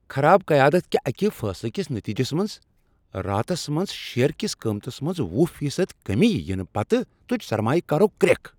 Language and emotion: Kashmiri, angry